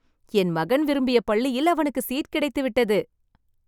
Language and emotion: Tamil, happy